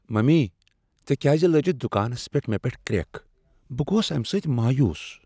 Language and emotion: Kashmiri, sad